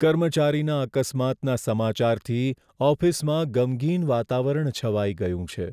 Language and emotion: Gujarati, sad